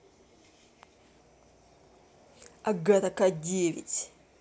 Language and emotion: Russian, angry